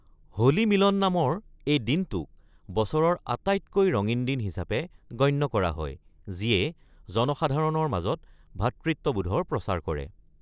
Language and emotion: Assamese, neutral